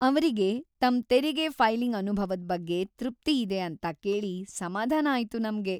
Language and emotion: Kannada, happy